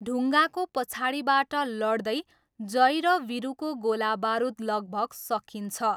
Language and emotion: Nepali, neutral